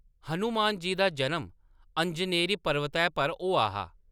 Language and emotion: Dogri, neutral